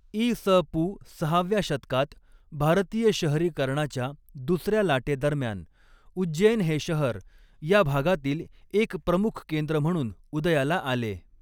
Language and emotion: Marathi, neutral